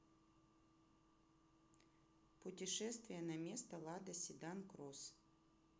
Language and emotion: Russian, neutral